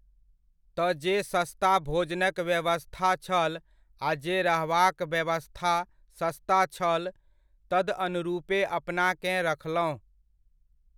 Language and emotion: Maithili, neutral